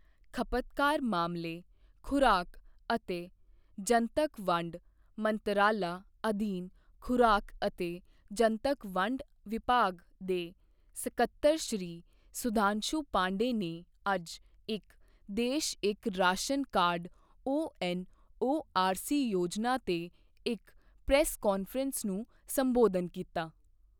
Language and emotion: Punjabi, neutral